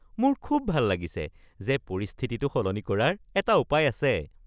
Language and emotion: Assamese, happy